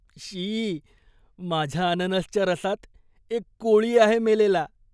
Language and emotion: Marathi, disgusted